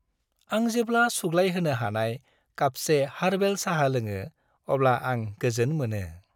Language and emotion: Bodo, happy